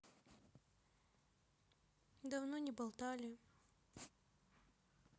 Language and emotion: Russian, sad